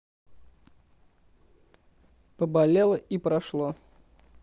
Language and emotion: Russian, neutral